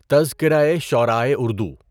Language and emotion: Urdu, neutral